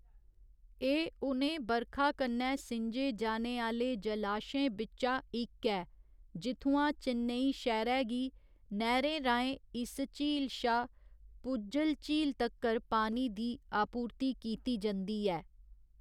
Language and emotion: Dogri, neutral